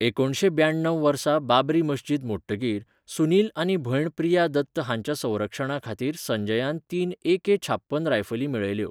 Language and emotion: Goan Konkani, neutral